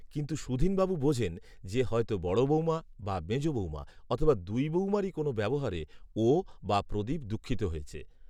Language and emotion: Bengali, neutral